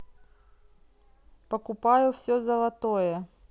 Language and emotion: Russian, neutral